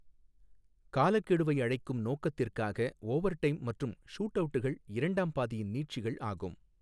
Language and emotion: Tamil, neutral